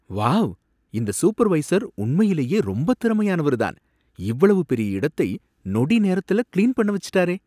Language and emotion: Tamil, surprised